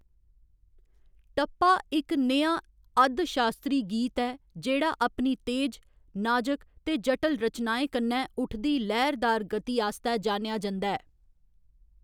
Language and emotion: Dogri, neutral